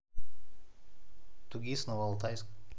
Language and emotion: Russian, neutral